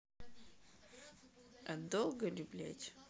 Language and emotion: Russian, angry